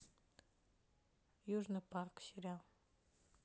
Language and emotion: Russian, neutral